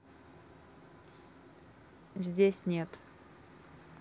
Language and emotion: Russian, neutral